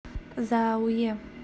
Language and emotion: Russian, positive